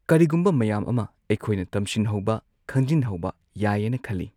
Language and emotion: Manipuri, neutral